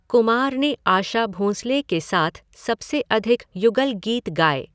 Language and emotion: Hindi, neutral